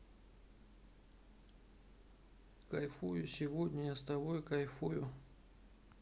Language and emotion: Russian, sad